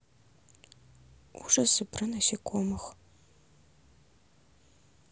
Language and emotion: Russian, sad